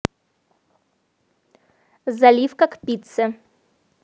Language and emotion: Russian, neutral